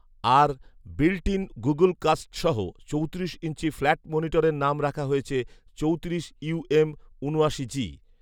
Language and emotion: Bengali, neutral